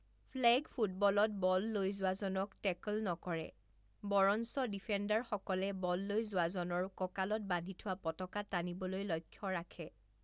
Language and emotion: Assamese, neutral